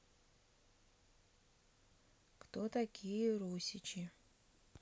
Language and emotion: Russian, neutral